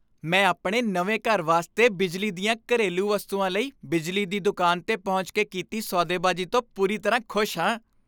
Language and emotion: Punjabi, happy